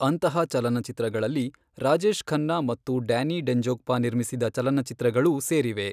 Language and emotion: Kannada, neutral